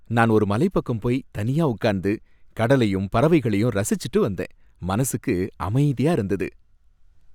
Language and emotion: Tamil, happy